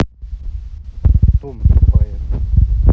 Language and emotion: Russian, neutral